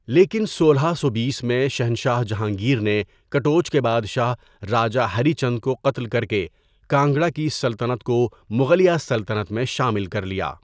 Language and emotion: Urdu, neutral